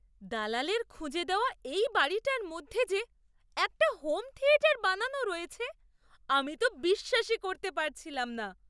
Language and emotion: Bengali, surprised